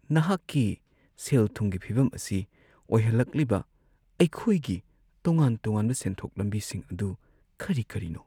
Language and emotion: Manipuri, sad